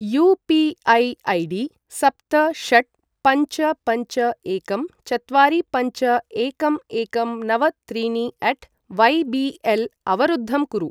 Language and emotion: Sanskrit, neutral